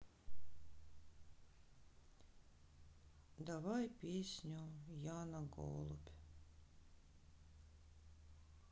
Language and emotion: Russian, sad